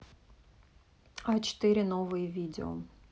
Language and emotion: Russian, neutral